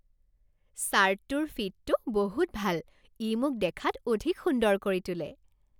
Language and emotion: Assamese, happy